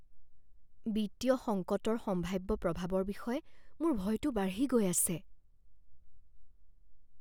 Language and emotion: Assamese, fearful